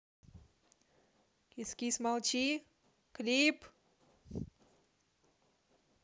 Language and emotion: Russian, neutral